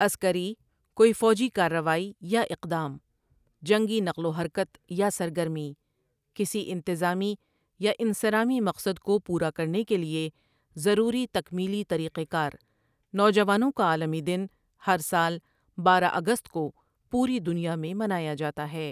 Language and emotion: Urdu, neutral